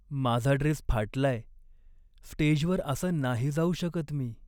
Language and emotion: Marathi, sad